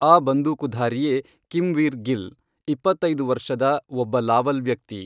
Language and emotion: Kannada, neutral